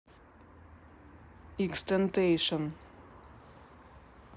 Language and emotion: Russian, neutral